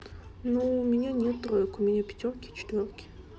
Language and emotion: Russian, neutral